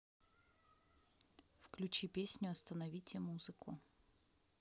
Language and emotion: Russian, neutral